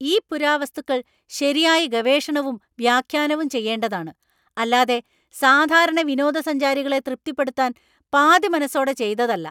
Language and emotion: Malayalam, angry